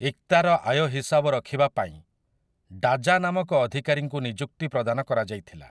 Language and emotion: Odia, neutral